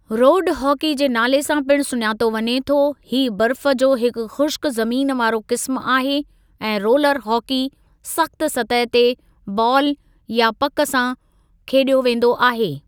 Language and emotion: Sindhi, neutral